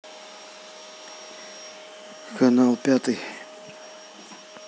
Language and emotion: Russian, neutral